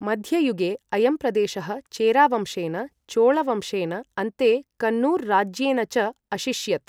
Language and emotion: Sanskrit, neutral